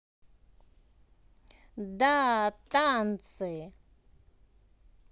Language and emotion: Russian, positive